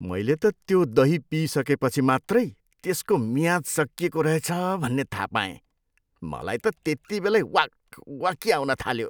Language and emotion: Nepali, disgusted